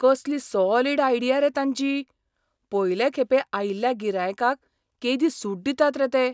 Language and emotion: Goan Konkani, surprised